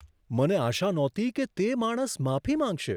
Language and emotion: Gujarati, surprised